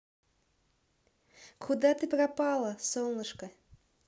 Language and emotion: Russian, positive